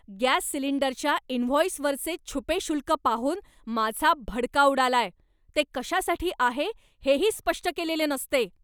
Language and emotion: Marathi, angry